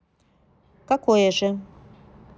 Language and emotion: Russian, neutral